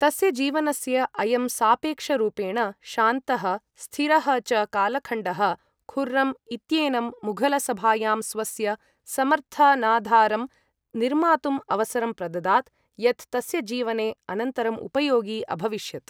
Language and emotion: Sanskrit, neutral